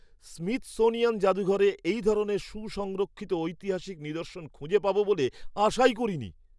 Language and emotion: Bengali, surprised